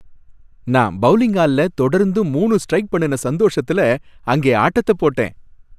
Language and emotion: Tamil, happy